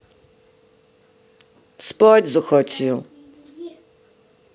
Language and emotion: Russian, sad